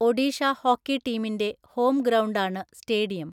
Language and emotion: Malayalam, neutral